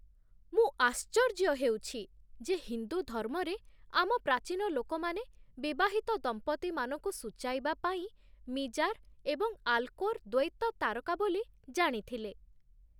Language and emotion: Odia, surprised